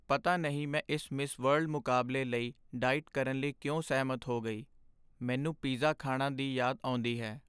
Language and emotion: Punjabi, sad